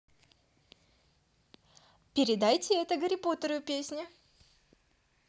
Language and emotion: Russian, positive